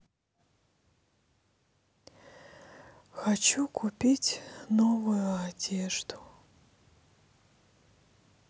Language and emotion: Russian, sad